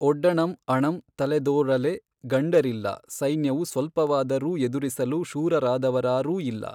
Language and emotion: Kannada, neutral